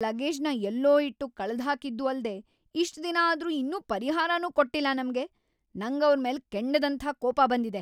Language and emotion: Kannada, angry